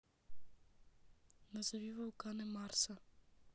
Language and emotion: Russian, neutral